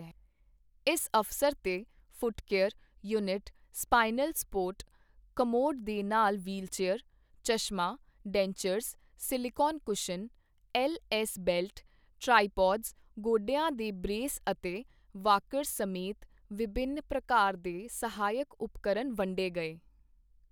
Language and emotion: Punjabi, neutral